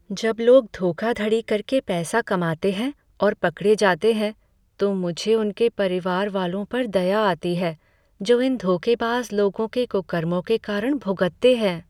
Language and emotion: Hindi, sad